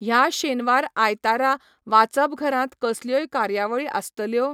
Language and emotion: Goan Konkani, neutral